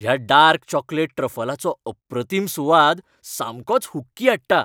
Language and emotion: Goan Konkani, happy